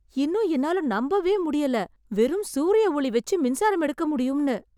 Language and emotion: Tamil, surprised